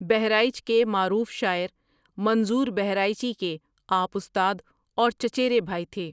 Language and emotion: Urdu, neutral